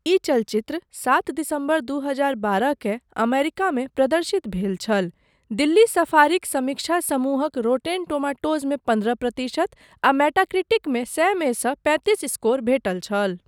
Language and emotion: Maithili, neutral